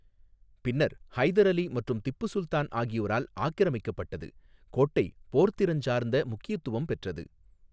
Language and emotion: Tamil, neutral